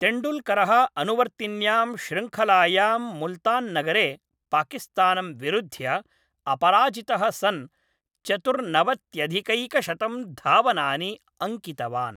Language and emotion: Sanskrit, neutral